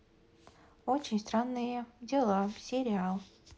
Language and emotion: Russian, neutral